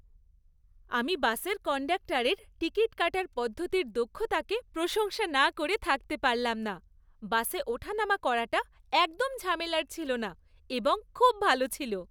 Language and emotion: Bengali, happy